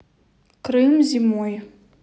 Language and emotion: Russian, neutral